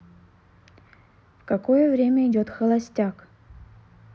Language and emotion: Russian, neutral